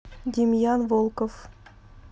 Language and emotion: Russian, neutral